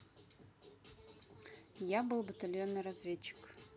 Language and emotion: Russian, neutral